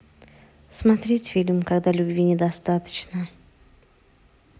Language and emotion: Russian, neutral